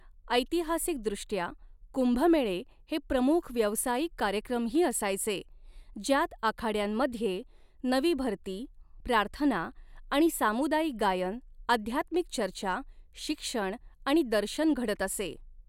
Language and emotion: Marathi, neutral